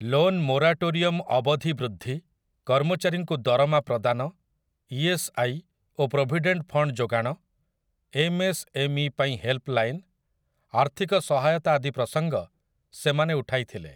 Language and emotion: Odia, neutral